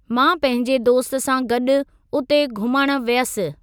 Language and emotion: Sindhi, neutral